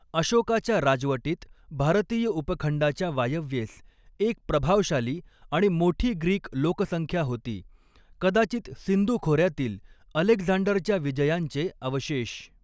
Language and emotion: Marathi, neutral